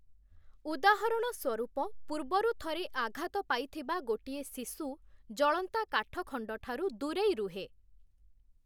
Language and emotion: Odia, neutral